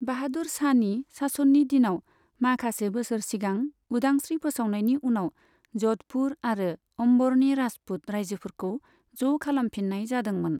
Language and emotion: Bodo, neutral